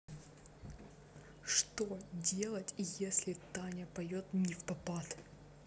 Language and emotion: Russian, angry